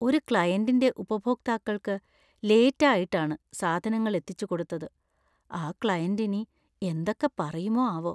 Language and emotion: Malayalam, fearful